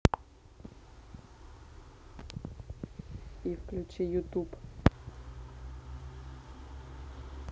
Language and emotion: Russian, neutral